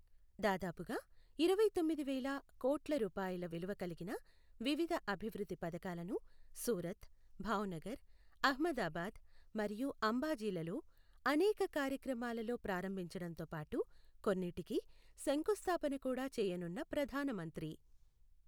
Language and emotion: Telugu, neutral